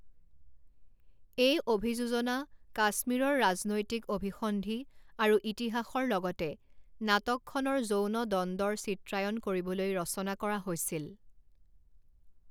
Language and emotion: Assamese, neutral